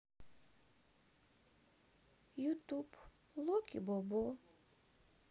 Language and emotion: Russian, sad